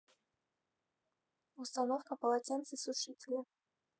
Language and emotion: Russian, neutral